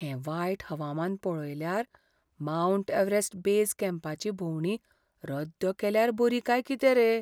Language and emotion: Goan Konkani, fearful